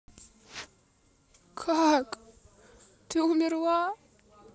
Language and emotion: Russian, sad